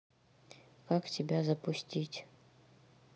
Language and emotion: Russian, neutral